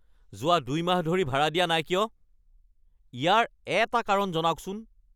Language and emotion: Assamese, angry